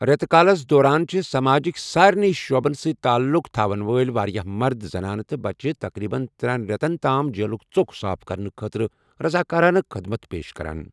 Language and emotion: Kashmiri, neutral